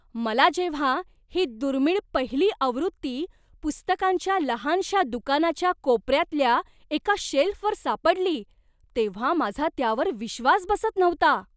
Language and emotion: Marathi, surprised